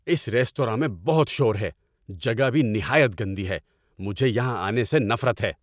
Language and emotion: Urdu, angry